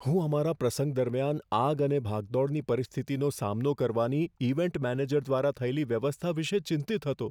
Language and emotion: Gujarati, fearful